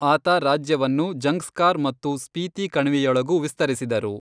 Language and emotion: Kannada, neutral